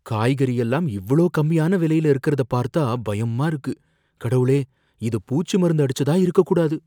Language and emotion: Tamil, fearful